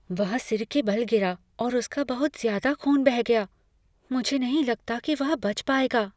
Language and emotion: Hindi, fearful